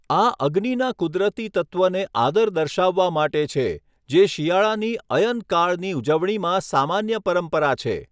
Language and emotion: Gujarati, neutral